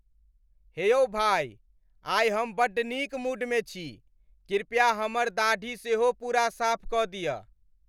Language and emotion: Maithili, happy